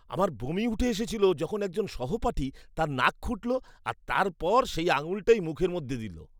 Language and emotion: Bengali, disgusted